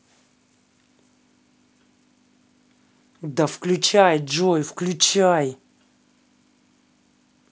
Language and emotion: Russian, angry